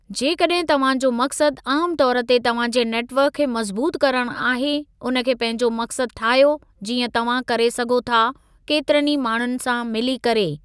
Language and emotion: Sindhi, neutral